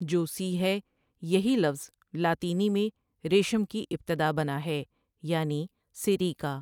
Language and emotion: Urdu, neutral